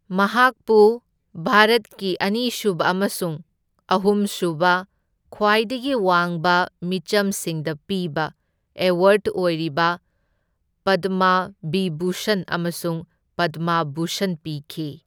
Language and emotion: Manipuri, neutral